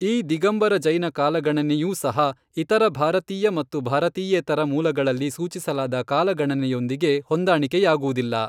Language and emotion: Kannada, neutral